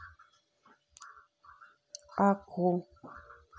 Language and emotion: Russian, neutral